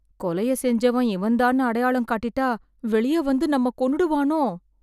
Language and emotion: Tamil, fearful